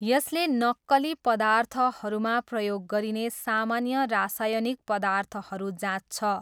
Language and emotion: Nepali, neutral